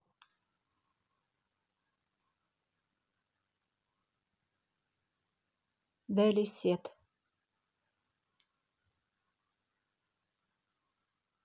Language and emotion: Russian, neutral